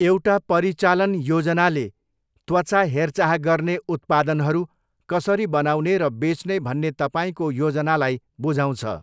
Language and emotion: Nepali, neutral